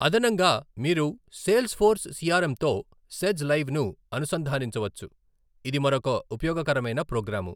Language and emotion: Telugu, neutral